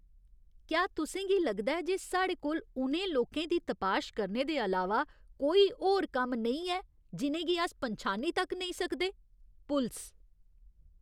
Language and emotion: Dogri, disgusted